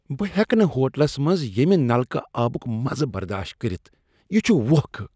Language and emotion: Kashmiri, disgusted